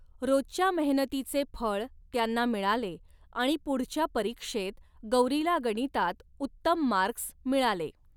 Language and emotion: Marathi, neutral